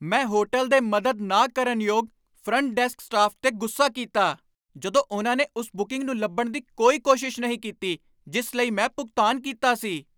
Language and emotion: Punjabi, angry